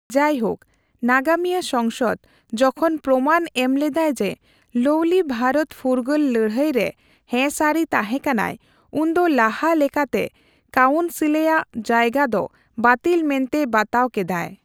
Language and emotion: Santali, neutral